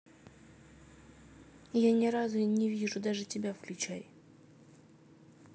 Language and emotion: Russian, neutral